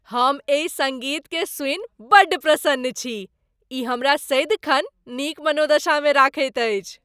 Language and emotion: Maithili, happy